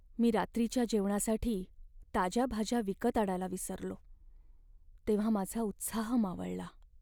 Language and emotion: Marathi, sad